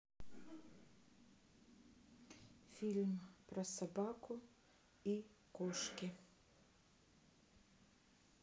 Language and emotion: Russian, neutral